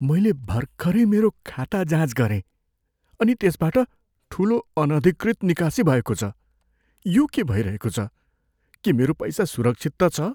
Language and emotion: Nepali, fearful